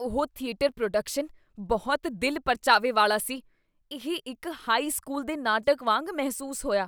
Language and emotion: Punjabi, disgusted